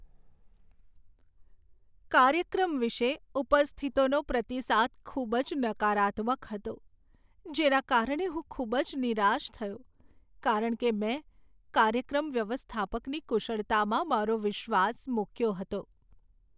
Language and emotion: Gujarati, sad